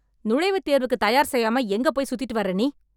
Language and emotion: Tamil, angry